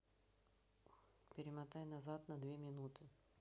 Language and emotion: Russian, neutral